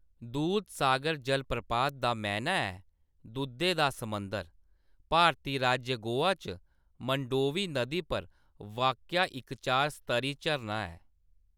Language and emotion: Dogri, neutral